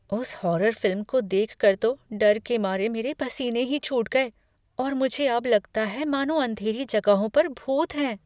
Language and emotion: Hindi, fearful